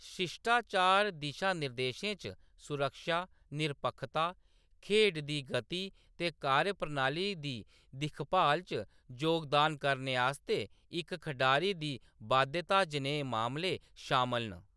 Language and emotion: Dogri, neutral